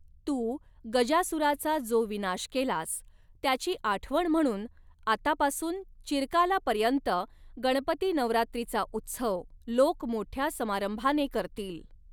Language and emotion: Marathi, neutral